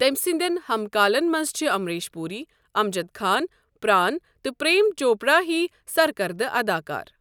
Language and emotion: Kashmiri, neutral